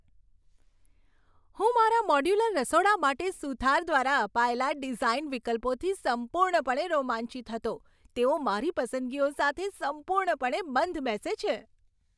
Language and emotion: Gujarati, happy